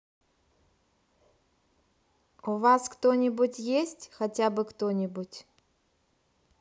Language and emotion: Russian, neutral